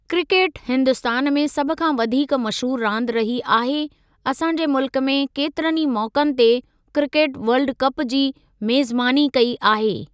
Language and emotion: Sindhi, neutral